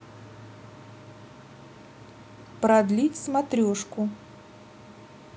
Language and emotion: Russian, neutral